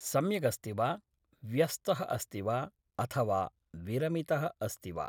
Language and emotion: Sanskrit, neutral